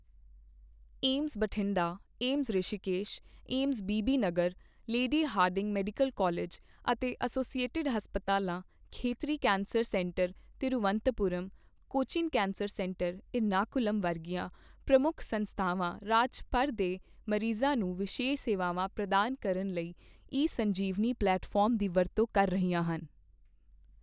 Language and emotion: Punjabi, neutral